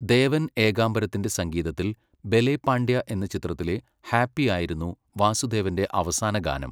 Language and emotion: Malayalam, neutral